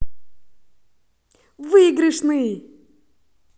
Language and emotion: Russian, positive